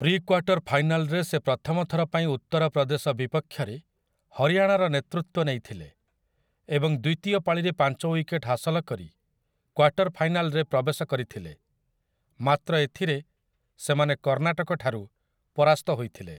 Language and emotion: Odia, neutral